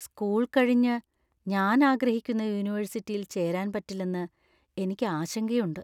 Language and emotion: Malayalam, fearful